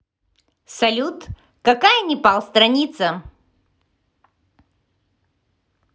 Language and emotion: Russian, positive